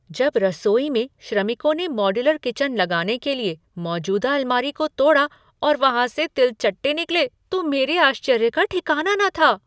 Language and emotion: Hindi, surprised